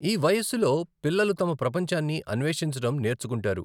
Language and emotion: Telugu, neutral